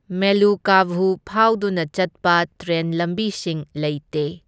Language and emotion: Manipuri, neutral